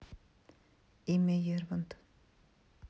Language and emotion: Russian, neutral